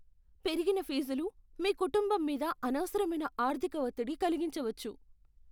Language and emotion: Telugu, fearful